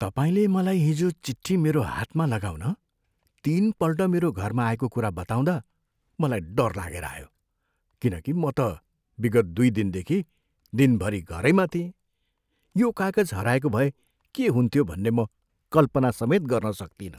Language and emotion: Nepali, fearful